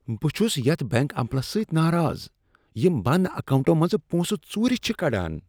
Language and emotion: Kashmiri, disgusted